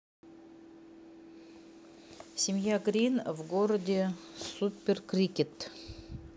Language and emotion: Russian, neutral